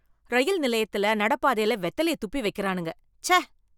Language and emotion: Tamil, disgusted